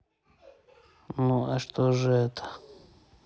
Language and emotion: Russian, neutral